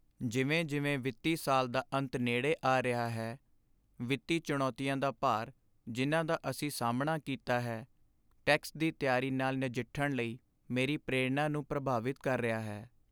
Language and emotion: Punjabi, sad